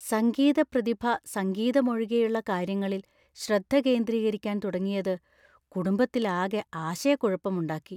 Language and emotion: Malayalam, fearful